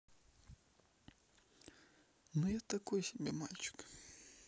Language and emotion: Russian, sad